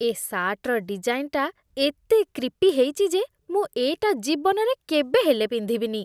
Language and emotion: Odia, disgusted